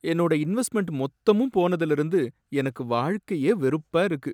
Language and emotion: Tamil, sad